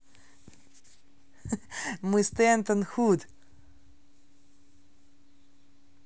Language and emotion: Russian, positive